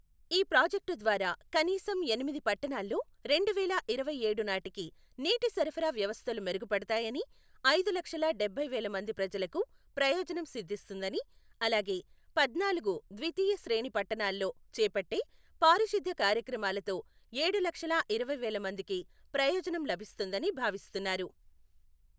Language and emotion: Telugu, neutral